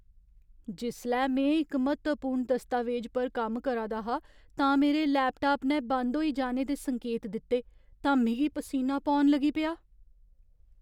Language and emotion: Dogri, fearful